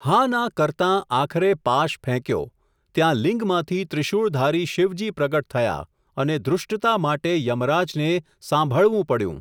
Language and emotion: Gujarati, neutral